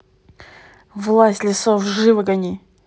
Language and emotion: Russian, angry